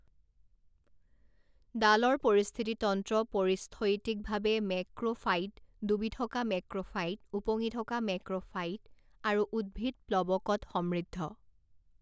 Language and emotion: Assamese, neutral